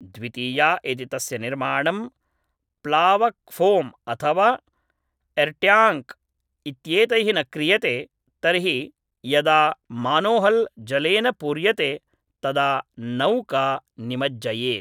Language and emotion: Sanskrit, neutral